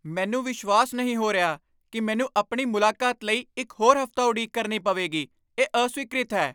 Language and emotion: Punjabi, angry